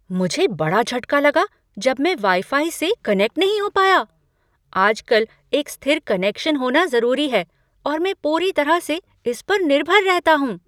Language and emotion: Hindi, surprised